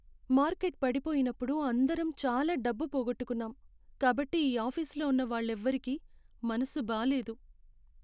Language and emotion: Telugu, sad